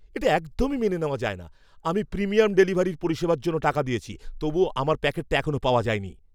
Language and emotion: Bengali, angry